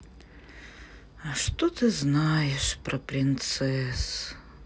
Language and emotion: Russian, sad